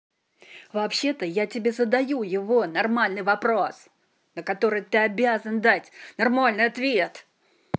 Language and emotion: Russian, angry